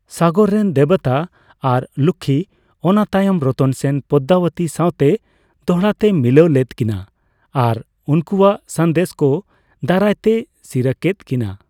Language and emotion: Santali, neutral